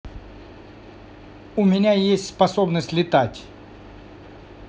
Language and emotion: Russian, neutral